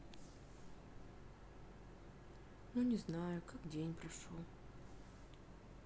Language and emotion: Russian, sad